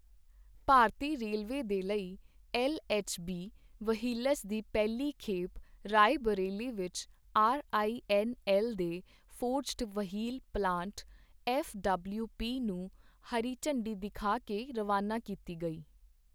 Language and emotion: Punjabi, neutral